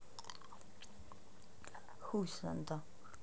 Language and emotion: Russian, neutral